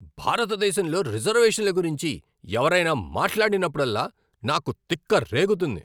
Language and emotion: Telugu, angry